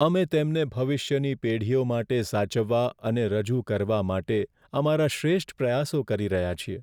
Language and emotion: Gujarati, sad